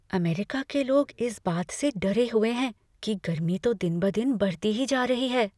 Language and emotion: Hindi, fearful